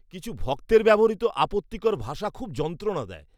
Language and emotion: Bengali, disgusted